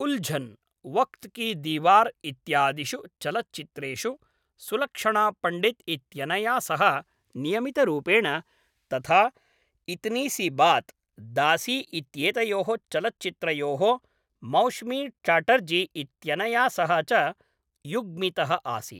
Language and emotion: Sanskrit, neutral